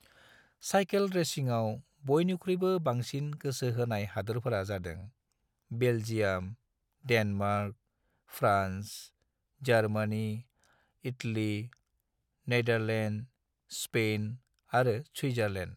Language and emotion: Bodo, neutral